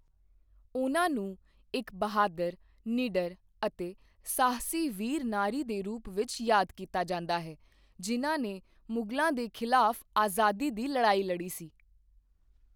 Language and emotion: Punjabi, neutral